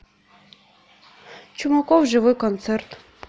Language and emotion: Russian, neutral